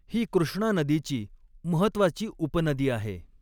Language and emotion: Marathi, neutral